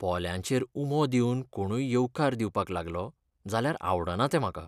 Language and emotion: Goan Konkani, sad